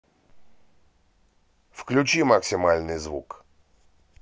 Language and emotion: Russian, neutral